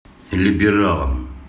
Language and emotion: Russian, neutral